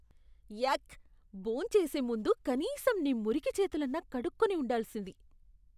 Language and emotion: Telugu, disgusted